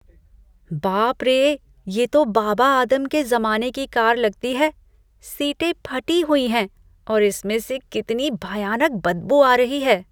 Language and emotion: Hindi, disgusted